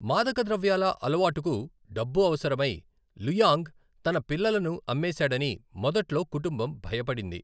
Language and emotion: Telugu, neutral